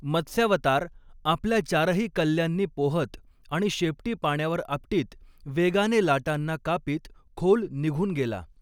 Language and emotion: Marathi, neutral